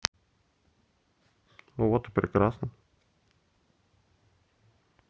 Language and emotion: Russian, neutral